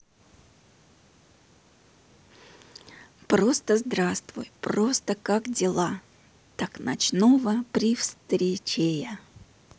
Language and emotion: Russian, neutral